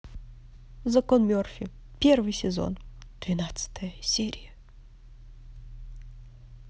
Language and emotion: Russian, positive